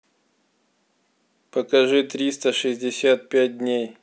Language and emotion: Russian, neutral